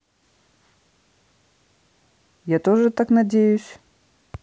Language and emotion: Russian, neutral